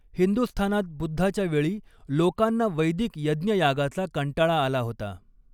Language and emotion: Marathi, neutral